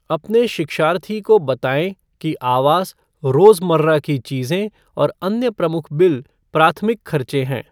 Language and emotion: Hindi, neutral